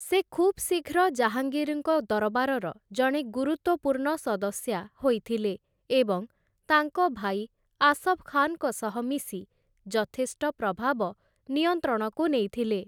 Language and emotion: Odia, neutral